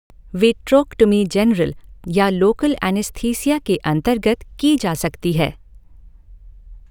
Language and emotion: Hindi, neutral